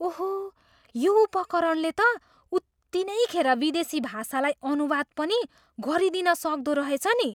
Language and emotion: Nepali, surprised